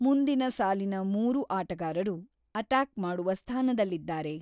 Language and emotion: Kannada, neutral